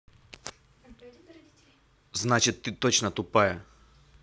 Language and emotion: Russian, angry